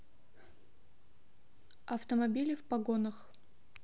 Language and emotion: Russian, neutral